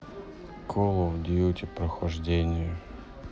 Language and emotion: Russian, sad